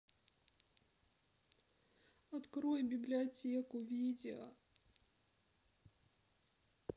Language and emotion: Russian, sad